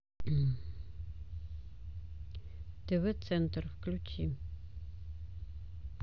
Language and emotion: Russian, neutral